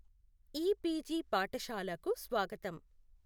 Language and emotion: Telugu, neutral